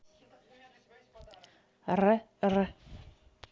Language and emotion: Russian, neutral